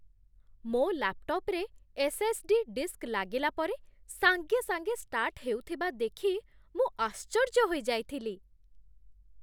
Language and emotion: Odia, surprised